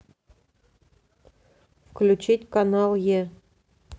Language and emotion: Russian, neutral